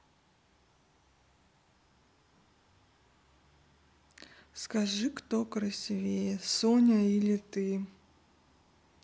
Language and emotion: Russian, neutral